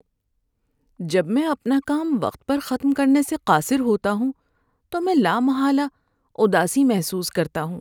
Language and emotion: Urdu, sad